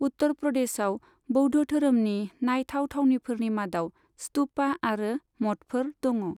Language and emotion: Bodo, neutral